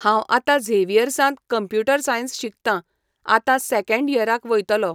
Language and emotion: Goan Konkani, neutral